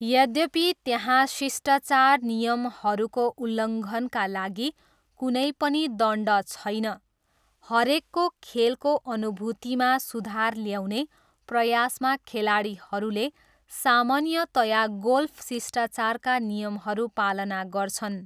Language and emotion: Nepali, neutral